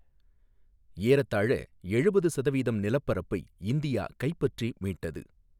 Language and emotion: Tamil, neutral